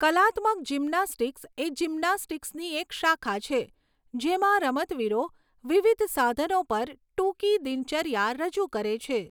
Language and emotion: Gujarati, neutral